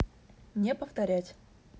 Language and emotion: Russian, neutral